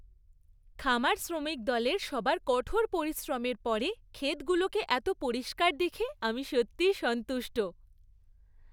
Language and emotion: Bengali, happy